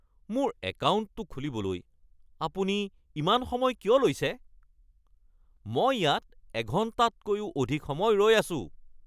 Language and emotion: Assamese, angry